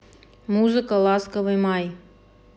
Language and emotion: Russian, neutral